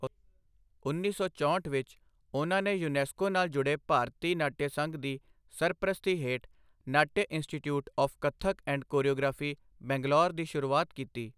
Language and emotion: Punjabi, neutral